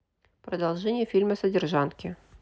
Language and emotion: Russian, neutral